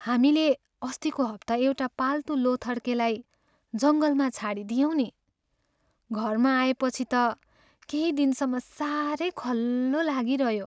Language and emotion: Nepali, sad